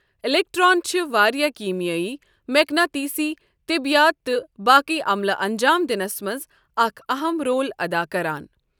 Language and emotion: Kashmiri, neutral